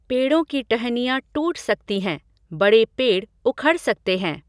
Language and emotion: Hindi, neutral